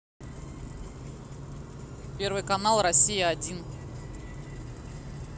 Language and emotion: Russian, neutral